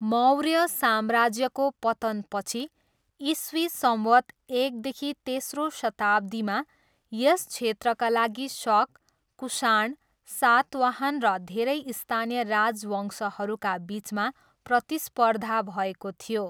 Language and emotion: Nepali, neutral